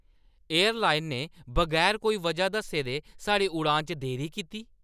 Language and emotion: Dogri, angry